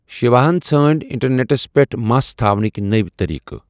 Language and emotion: Kashmiri, neutral